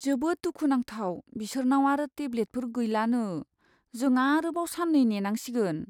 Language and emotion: Bodo, sad